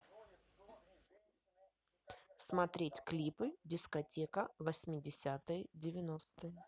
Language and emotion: Russian, neutral